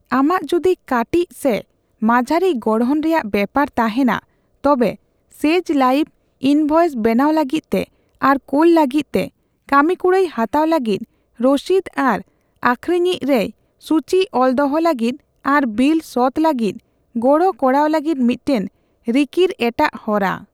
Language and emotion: Santali, neutral